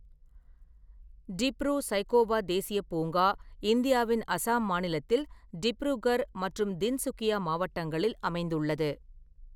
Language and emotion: Tamil, neutral